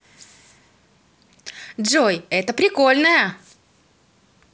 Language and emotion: Russian, positive